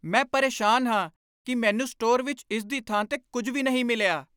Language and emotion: Punjabi, angry